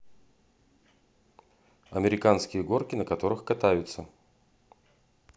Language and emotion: Russian, neutral